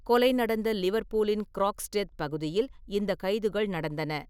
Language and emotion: Tamil, neutral